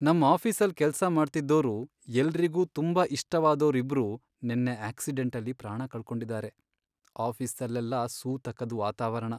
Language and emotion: Kannada, sad